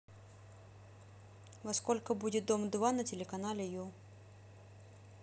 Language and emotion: Russian, neutral